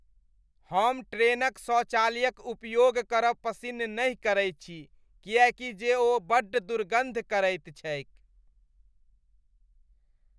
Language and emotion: Maithili, disgusted